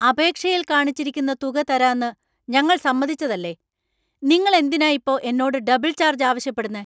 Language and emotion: Malayalam, angry